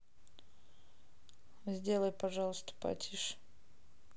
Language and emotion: Russian, neutral